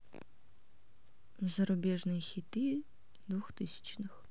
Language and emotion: Russian, neutral